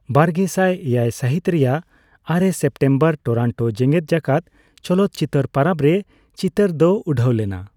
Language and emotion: Santali, neutral